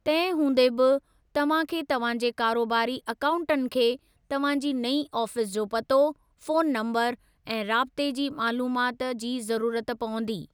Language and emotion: Sindhi, neutral